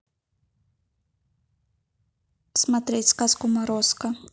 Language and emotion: Russian, neutral